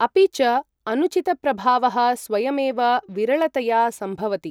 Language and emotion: Sanskrit, neutral